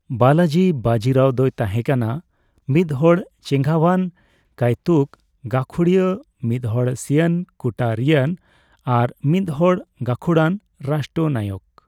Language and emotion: Santali, neutral